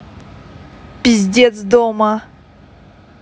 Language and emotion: Russian, angry